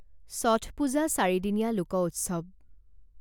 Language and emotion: Assamese, neutral